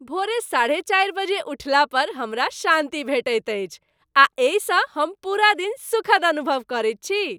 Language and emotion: Maithili, happy